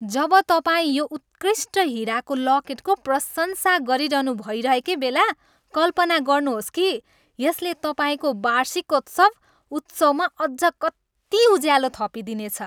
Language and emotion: Nepali, happy